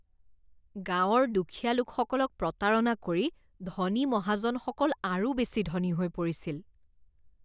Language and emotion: Assamese, disgusted